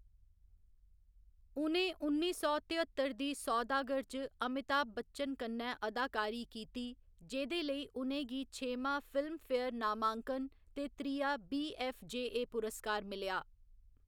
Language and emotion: Dogri, neutral